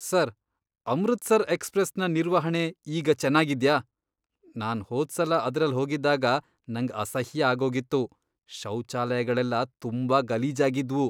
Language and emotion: Kannada, disgusted